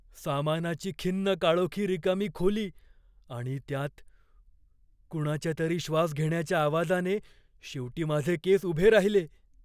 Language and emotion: Marathi, fearful